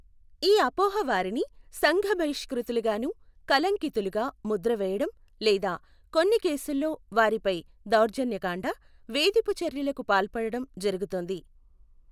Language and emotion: Telugu, neutral